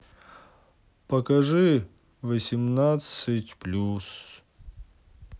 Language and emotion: Russian, sad